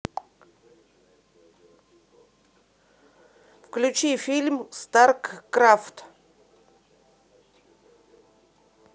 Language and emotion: Russian, neutral